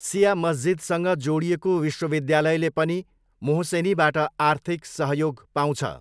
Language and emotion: Nepali, neutral